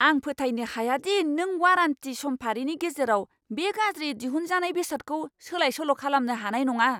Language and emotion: Bodo, angry